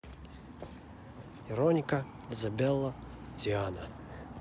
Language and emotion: Russian, neutral